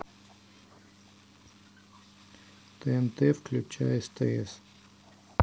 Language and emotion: Russian, neutral